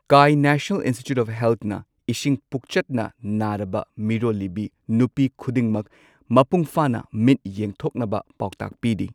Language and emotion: Manipuri, neutral